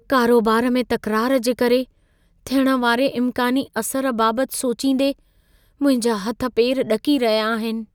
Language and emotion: Sindhi, fearful